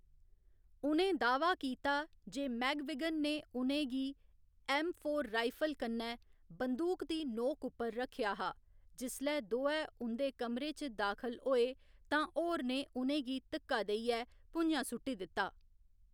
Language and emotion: Dogri, neutral